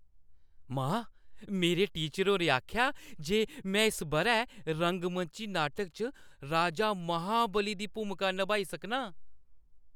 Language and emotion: Dogri, happy